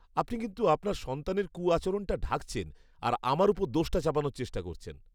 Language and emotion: Bengali, disgusted